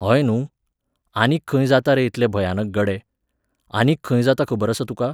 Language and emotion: Goan Konkani, neutral